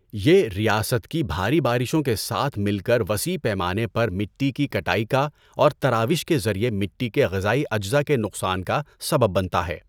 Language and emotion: Urdu, neutral